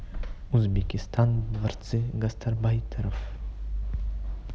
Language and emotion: Russian, neutral